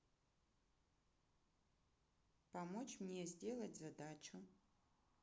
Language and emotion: Russian, neutral